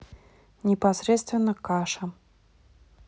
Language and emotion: Russian, neutral